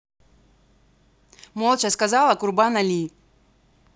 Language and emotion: Russian, angry